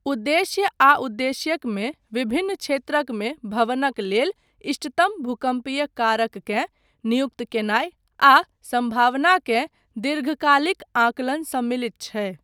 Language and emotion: Maithili, neutral